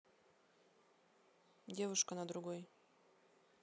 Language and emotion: Russian, neutral